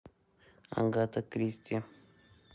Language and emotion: Russian, neutral